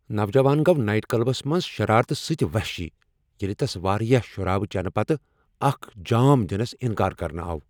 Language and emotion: Kashmiri, angry